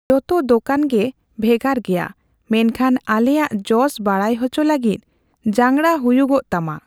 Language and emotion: Santali, neutral